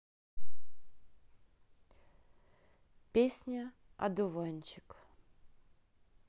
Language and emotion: Russian, neutral